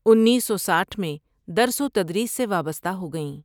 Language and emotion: Urdu, neutral